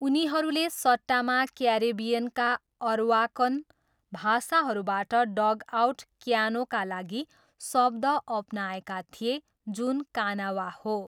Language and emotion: Nepali, neutral